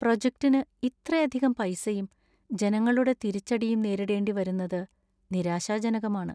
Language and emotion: Malayalam, sad